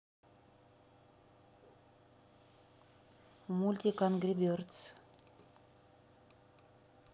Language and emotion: Russian, neutral